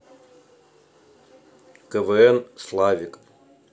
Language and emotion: Russian, neutral